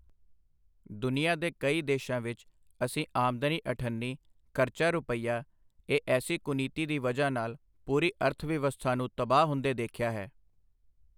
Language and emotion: Punjabi, neutral